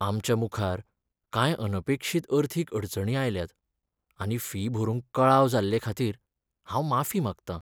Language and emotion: Goan Konkani, sad